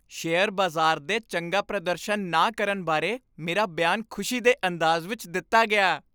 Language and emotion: Punjabi, happy